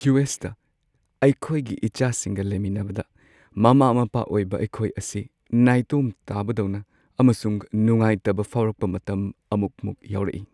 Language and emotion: Manipuri, sad